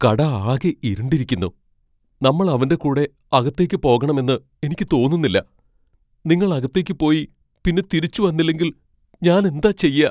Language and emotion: Malayalam, fearful